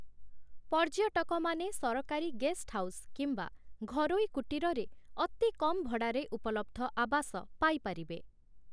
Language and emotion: Odia, neutral